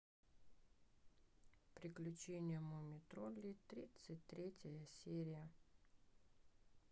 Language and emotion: Russian, sad